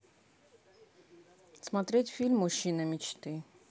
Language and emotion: Russian, neutral